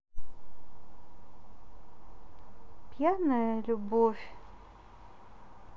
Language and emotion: Russian, neutral